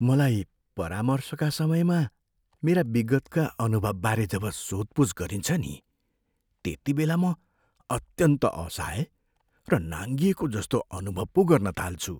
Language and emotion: Nepali, fearful